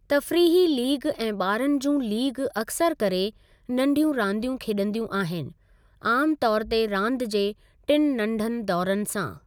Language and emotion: Sindhi, neutral